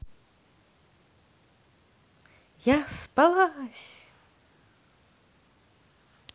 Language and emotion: Russian, positive